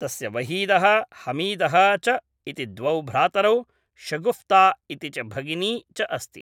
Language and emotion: Sanskrit, neutral